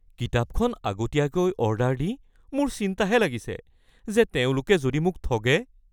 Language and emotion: Assamese, fearful